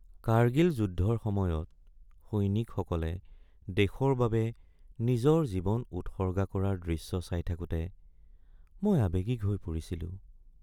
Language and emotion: Assamese, sad